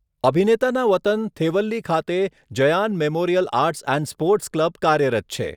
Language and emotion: Gujarati, neutral